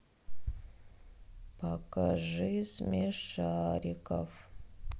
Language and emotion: Russian, sad